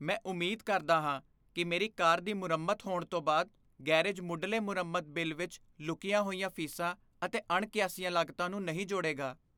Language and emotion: Punjabi, fearful